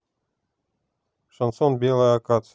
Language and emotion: Russian, neutral